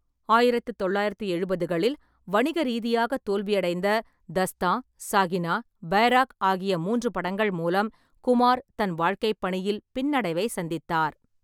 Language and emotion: Tamil, neutral